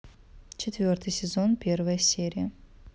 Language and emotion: Russian, neutral